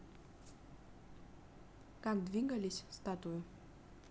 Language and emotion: Russian, neutral